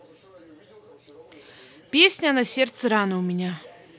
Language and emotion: Russian, neutral